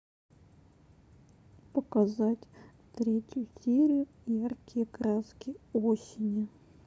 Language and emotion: Russian, sad